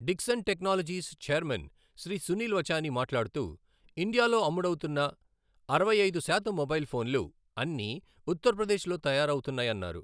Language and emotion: Telugu, neutral